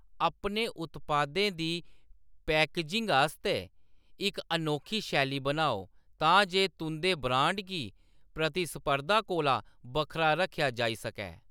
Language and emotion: Dogri, neutral